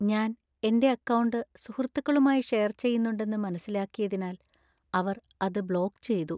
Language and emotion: Malayalam, sad